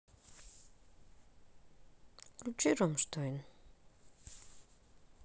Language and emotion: Russian, neutral